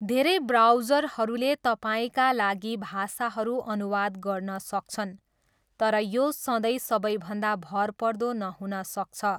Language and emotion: Nepali, neutral